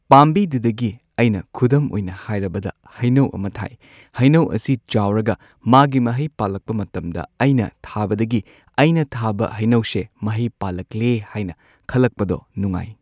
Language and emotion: Manipuri, neutral